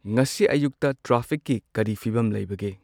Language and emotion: Manipuri, neutral